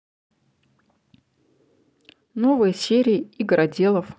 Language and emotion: Russian, neutral